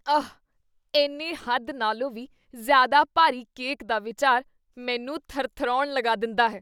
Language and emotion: Punjabi, disgusted